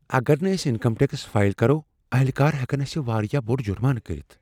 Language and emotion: Kashmiri, fearful